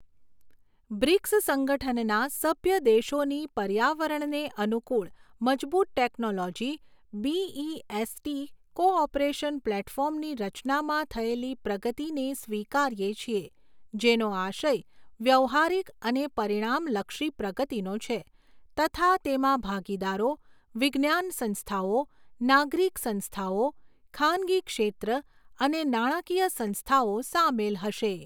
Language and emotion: Gujarati, neutral